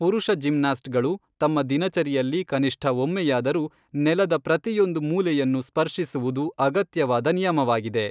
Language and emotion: Kannada, neutral